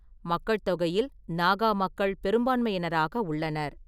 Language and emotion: Tamil, neutral